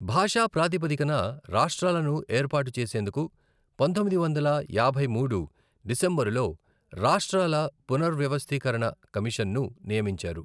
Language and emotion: Telugu, neutral